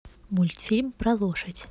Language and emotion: Russian, neutral